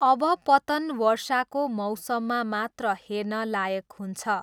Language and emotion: Nepali, neutral